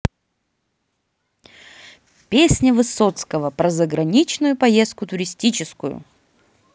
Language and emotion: Russian, positive